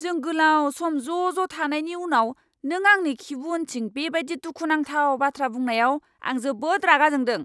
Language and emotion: Bodo, angry